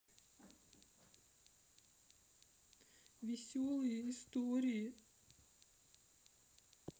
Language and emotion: Russian, sad